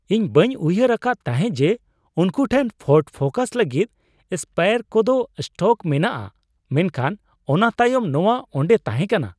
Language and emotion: Santali, surprised